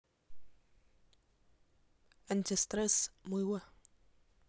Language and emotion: Russian, neutral